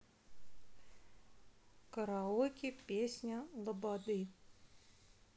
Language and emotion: Russian, neutral